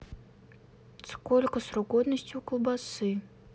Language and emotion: Russian, neutral